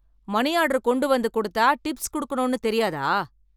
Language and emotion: Tamil, angry